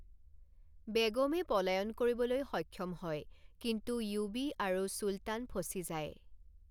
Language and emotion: Assamese, neutral